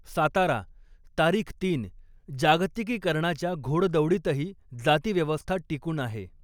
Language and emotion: Marathi, neutral